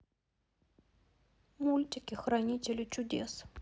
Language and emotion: Russian, sad